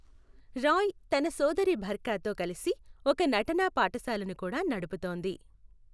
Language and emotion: Telugu, neutral